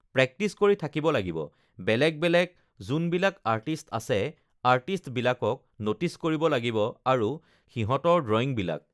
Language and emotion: Assamese, neutral